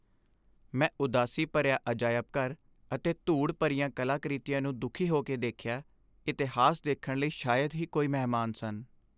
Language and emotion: Punjabi, sad